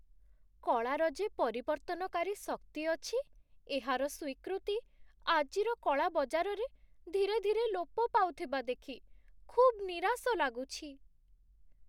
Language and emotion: Odia, sad